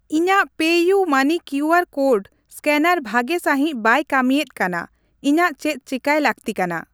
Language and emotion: Santali, neutral